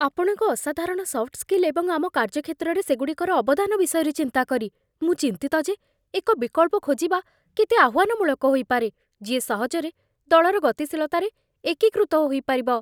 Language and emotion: Odia, fearful